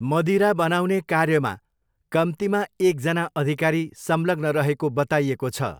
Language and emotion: Nepali, neutral